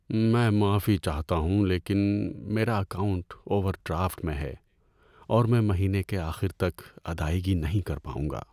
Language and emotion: Urdu, sad